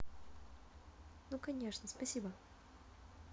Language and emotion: Russian, neutral